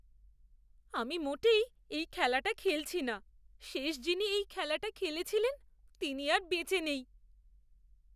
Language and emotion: Bengali, fearful